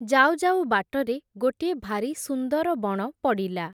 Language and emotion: Odia, neutral